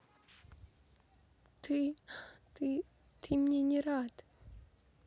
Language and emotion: Russian, sad